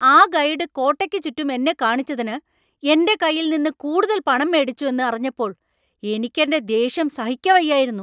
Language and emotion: Malayalam, angry